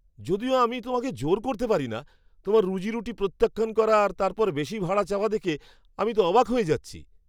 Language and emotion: Bengali, surprised